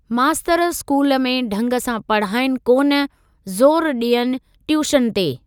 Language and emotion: Sindhi, neutral